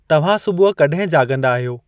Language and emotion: Sindhi, neutral